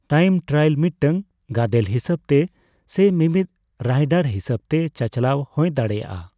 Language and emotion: Santali, neutral